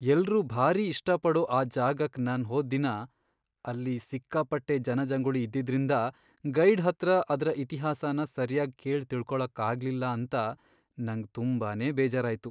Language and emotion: Kannada, sad